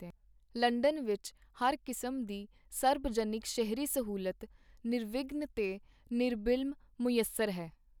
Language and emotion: Punjabi, neutral